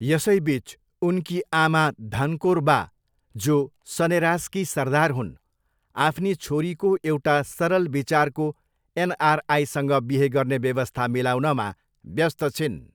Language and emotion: Nepali, neutral